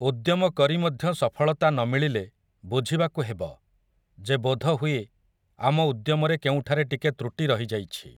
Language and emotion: Odia, neutral